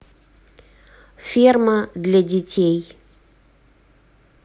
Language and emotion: Russian, neutral